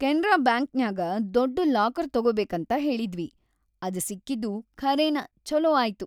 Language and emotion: Kannada, happy